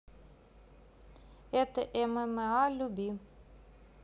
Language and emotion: Russian, neutral